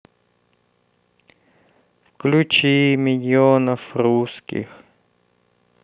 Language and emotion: Russian, sad